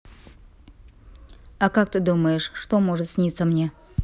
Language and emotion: Russian, neutral